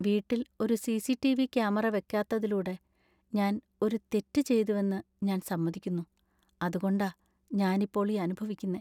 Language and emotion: Malayalam, sad